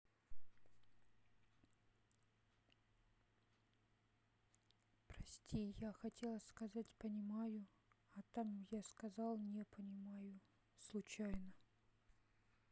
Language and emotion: Russian, sad